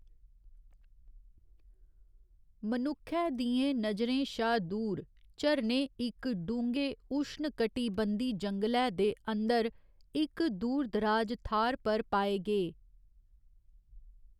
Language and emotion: Dogri, neutral